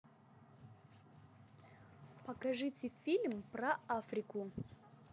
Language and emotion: Russian, positive